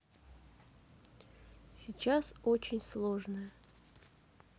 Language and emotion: Russian, sad